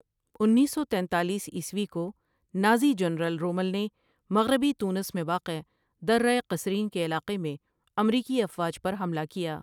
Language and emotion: Urdu, neutral